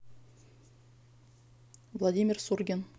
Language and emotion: Russian, neutral